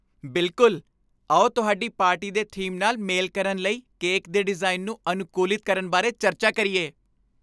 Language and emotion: Punjabi, happy